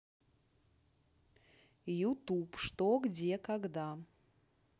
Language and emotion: Russian, neutral